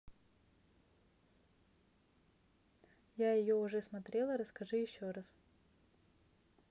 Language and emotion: Russian, neutral